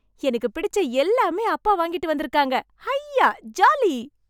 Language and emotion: Tamil, happy